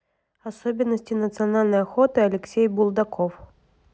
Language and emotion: Russian, neutral